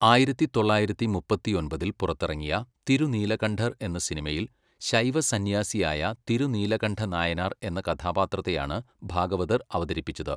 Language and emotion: Malayalam, neutral